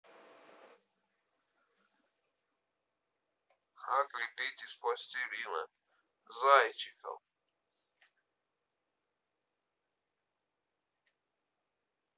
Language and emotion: Russian, neutral